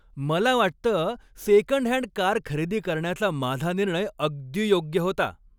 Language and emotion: Marathi, happy